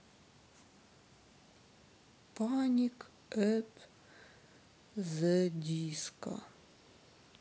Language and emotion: Russian, sad